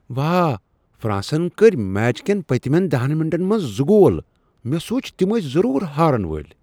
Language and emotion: Kashmiri, surprised